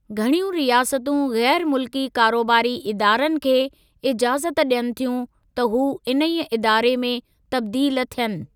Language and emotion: Sindhi, neutral